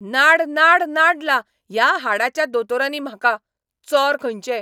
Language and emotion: Goan Konkani, angry